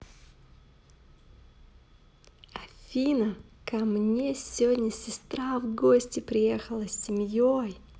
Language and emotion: Russian, positive